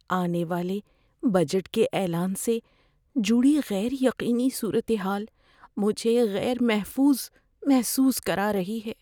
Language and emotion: Urdu, fearful